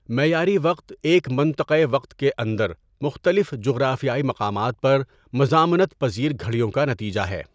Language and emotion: Urdu, neutral